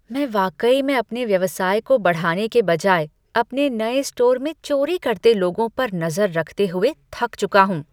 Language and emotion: Hindi, disgusted